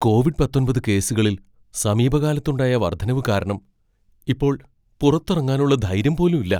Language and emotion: Malayalam, fearful